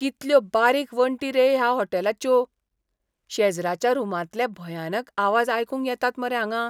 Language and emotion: Goan Konkani, disgusted